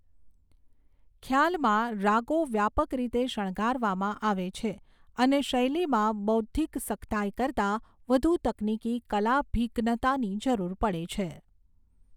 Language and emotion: Gujarati, neutral